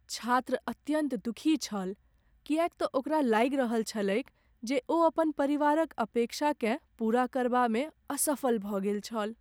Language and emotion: Maithili, sad